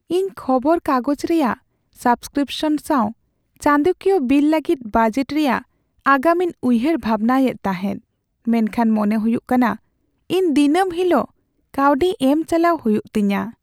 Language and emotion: Santali, sad